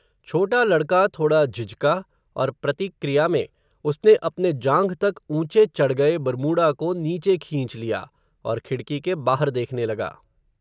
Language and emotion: Hindi, neutral